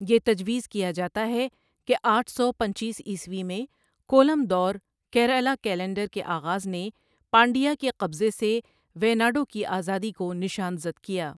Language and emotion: Urdu, neutral